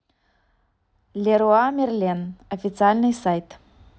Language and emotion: Russian, neutral